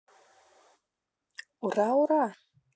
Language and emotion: Russian, positive